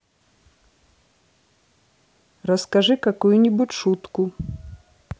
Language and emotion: Russian, neutral